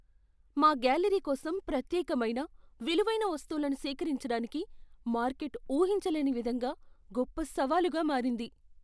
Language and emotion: Telugu, fearful